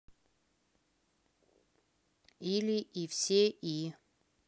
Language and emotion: Russian, neutral